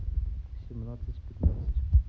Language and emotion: Russian, neutral